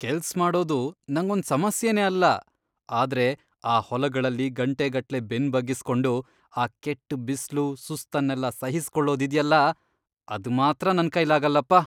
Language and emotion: Kannada, disgusted